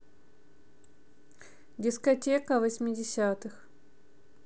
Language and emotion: Russian, neutral